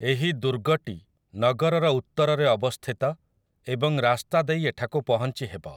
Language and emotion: Odia, neutral